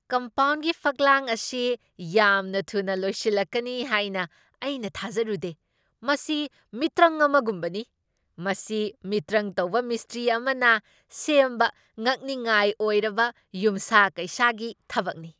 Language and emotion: Manipuri, surprised